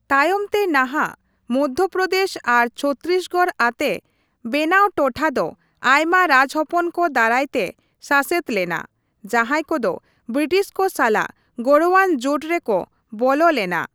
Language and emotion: Santali, neutral